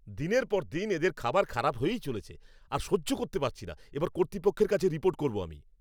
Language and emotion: Bengali, angry